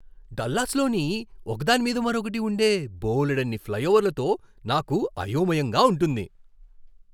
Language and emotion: Telugu, surprised